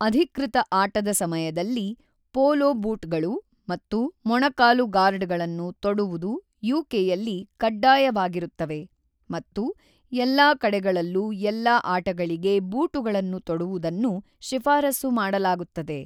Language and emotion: Kannada, neutral